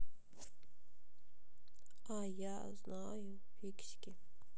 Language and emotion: Russian, sad